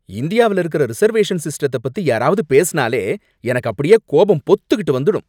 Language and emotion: Tamil, angry